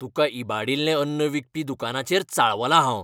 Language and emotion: Goan Konkani, angry